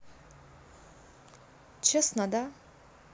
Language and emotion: Russian, neutral